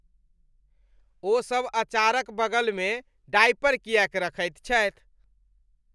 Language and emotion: Maithili, disgusted